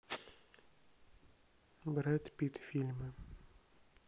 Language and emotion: Russian, neutral